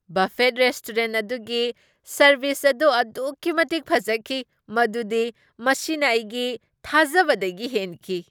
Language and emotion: Manipuri, surprised